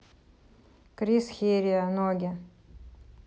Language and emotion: Russian, neutral